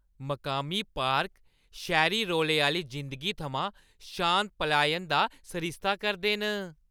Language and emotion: Dogri, happy